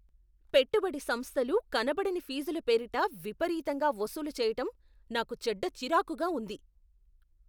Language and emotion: Telugu, angry